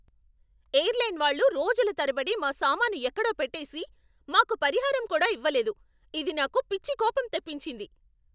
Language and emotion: Telugu, angry